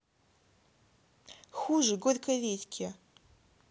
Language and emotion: Russian, angry